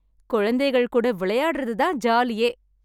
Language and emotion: Tamil, happy